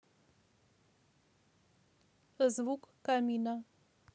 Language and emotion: Russian, neutral